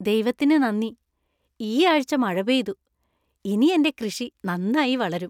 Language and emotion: Malayalam, happy